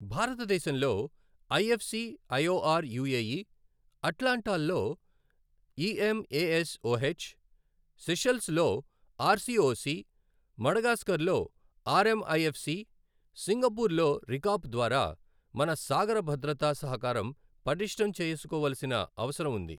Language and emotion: Telugu, neutral